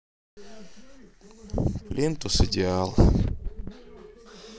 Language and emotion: Russian, neutral